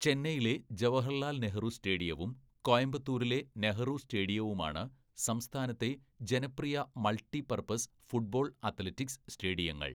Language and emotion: Malayalam, neutral